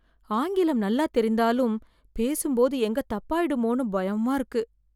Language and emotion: Tamil, fearful